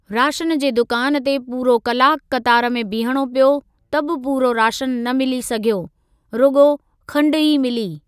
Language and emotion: Sindhi, neutral